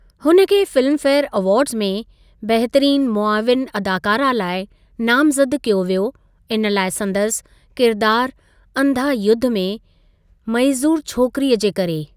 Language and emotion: Sindhi, neutral